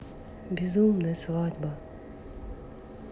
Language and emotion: Russian, sad